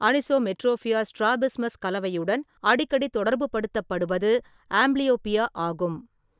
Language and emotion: Tamil, neutral